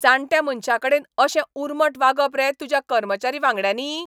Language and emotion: Goan Konkani, angry